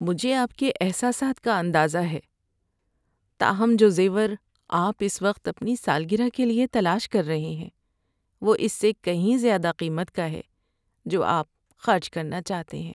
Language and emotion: Urdu, sad